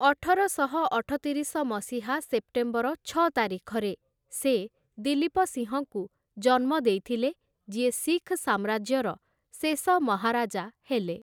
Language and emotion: Odia, neutral